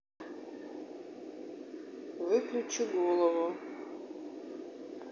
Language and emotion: Russian, neutral